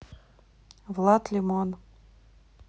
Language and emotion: Russian, neutral